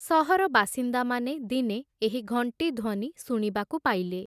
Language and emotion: Odia, neutral